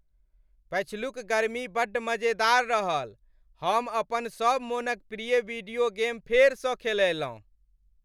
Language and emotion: Maithili, happy